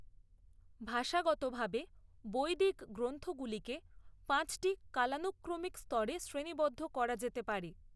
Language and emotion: Bengali, neutral